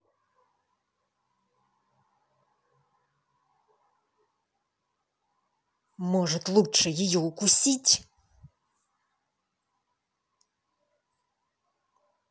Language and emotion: Russian, angry